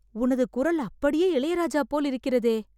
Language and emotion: Tamil, surprised